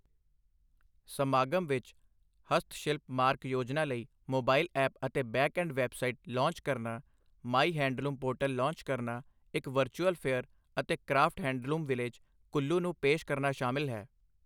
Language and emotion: Punjabi, neutral